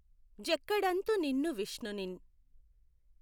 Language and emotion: Telugu, neutral